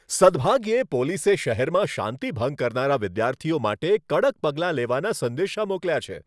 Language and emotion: Gujarati, happy